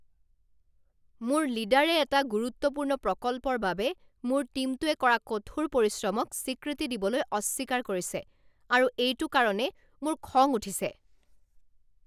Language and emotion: Assamese, angry